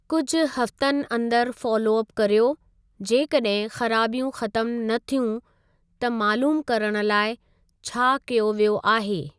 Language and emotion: Sindhi, neutral